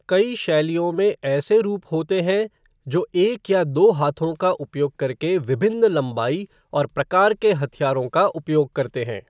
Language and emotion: Hindi, neutral